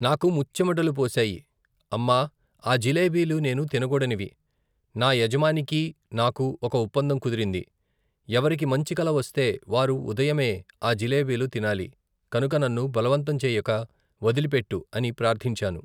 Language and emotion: Telugu, neutral